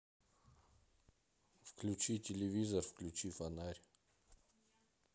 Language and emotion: Russian, neutral